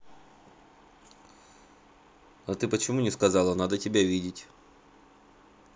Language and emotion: Russian, neutral